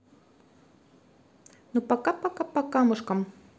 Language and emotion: Russian, positive